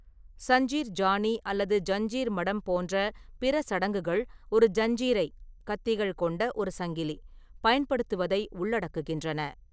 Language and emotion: Tamil, neutral